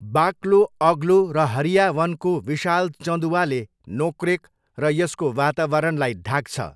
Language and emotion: Nepali, neutral